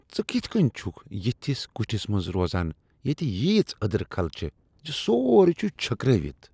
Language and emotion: Kashmiri, disgusted